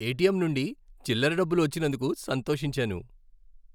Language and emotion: Telugu, happy